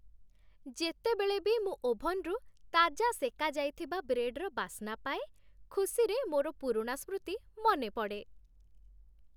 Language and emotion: Odia, happy